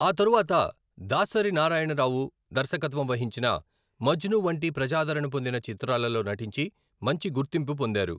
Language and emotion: Telugu, neutral